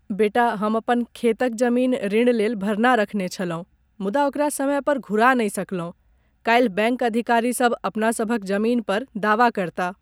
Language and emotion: Maithili, sad